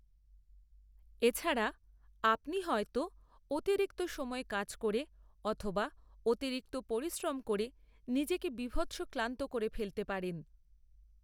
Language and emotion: Bengali, neutral